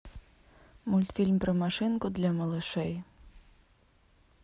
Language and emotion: Russian, neutral